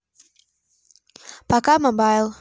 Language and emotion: Russian, neutral